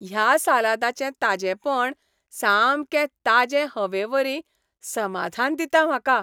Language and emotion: Goan Konkani, happy